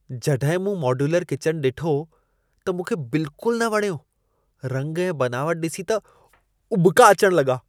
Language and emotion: Sindhi, disgusted